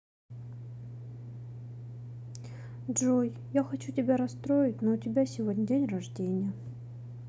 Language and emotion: Russian, sad